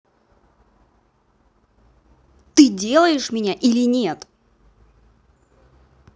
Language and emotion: Russian, angry